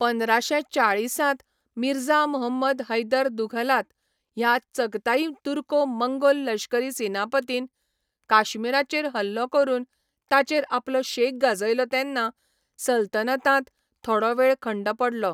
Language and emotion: Goan Konkani, neutral